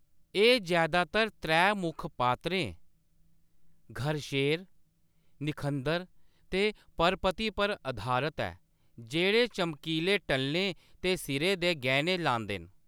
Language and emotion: Dogri, neutral